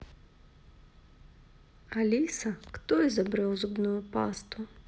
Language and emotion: Russian, neutral